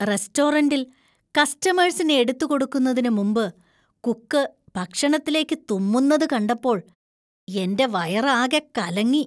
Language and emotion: Malayalam, disgusted